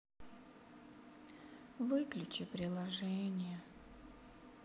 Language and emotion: Russian, sad